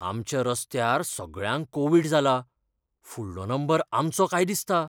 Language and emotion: Goan Konkani, fearful